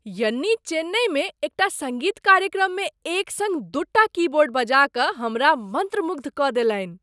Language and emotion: Maithili, surprised